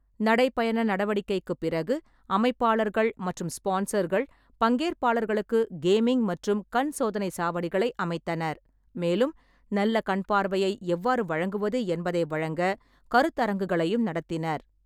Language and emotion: Tamil, neutral